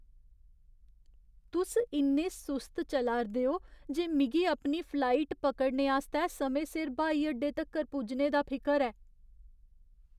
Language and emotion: Dogri, fearful